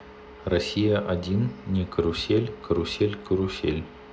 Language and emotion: Russian, neutral